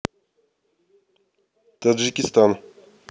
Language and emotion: Russian, neutral